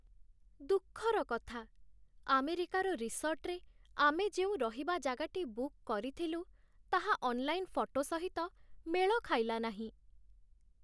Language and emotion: Odia, sad